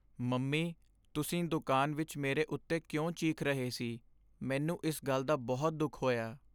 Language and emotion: Punjabi, sad